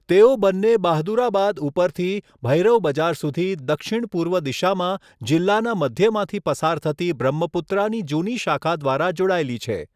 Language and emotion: Gujarati, neutral